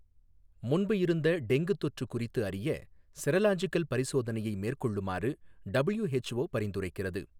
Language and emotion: Tamil, neutral